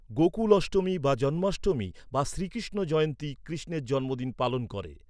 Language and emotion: Bengali, neutral